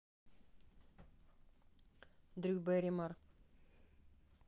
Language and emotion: Russian, neutral